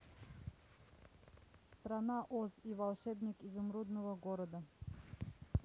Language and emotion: Russian, neutral